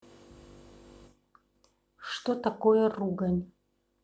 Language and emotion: Russian, neutral